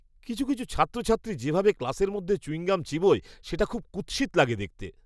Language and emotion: Bengali, disgusted